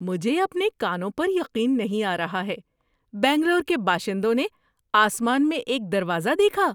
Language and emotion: Urdu, surprised